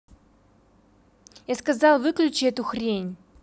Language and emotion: Russian, angry